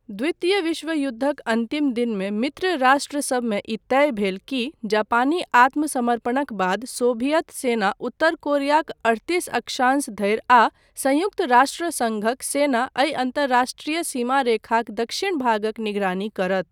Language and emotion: Maithili, neutral